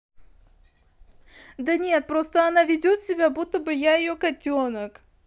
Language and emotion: Russian, positive